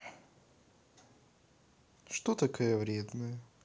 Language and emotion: Russian, neutral